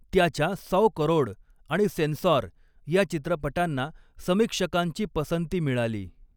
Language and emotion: Marathi, neutral